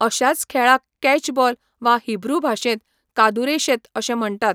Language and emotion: Goan Konkani, neutral